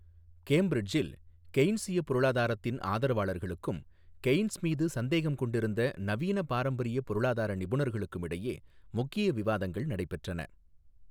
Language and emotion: Tamil, neutral